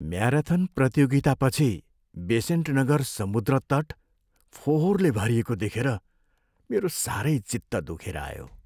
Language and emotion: Nepali, sad